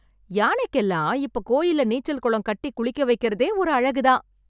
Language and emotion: Tamil, happy